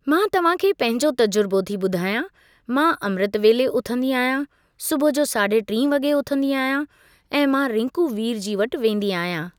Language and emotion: Sindhi, neutral